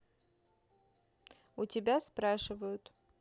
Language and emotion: Russian, neutral